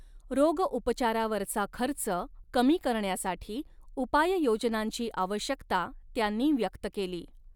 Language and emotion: Marathi, neutral